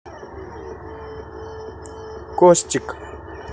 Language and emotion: Russian, neutral